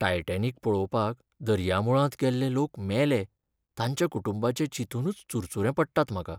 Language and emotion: Goan Konkani, sad